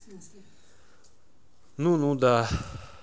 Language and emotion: Russian, neutral